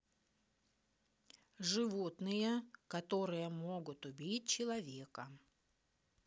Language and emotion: Russian, neutral